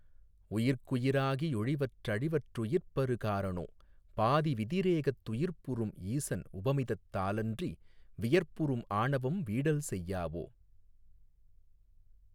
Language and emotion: Tamil, neutral